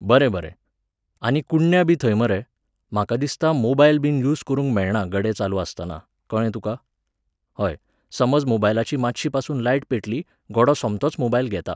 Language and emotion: Goan Konkani, neutral